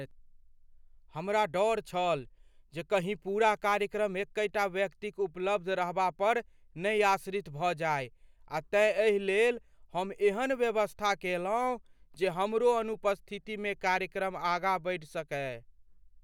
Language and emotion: Maithili, fearful